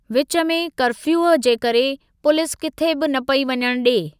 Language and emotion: Sindhi, neutral